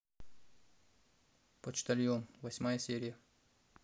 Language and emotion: Russian, neutral